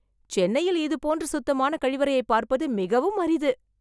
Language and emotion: Tamil, surprised